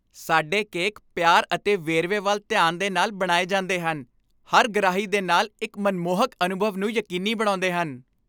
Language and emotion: Punjabi, happy